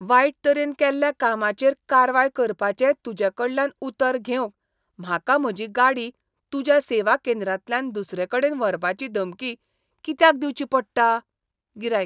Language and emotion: Goan Konkani, disgusted